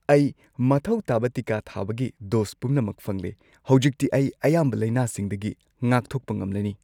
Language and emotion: Manipuri, happy